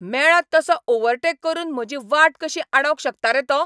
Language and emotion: Goan Konkani, angry